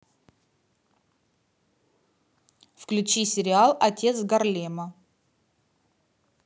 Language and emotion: Russian, neutral